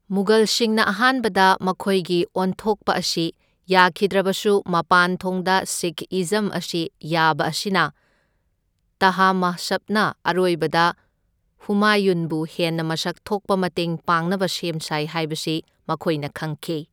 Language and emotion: Manipuri, neutral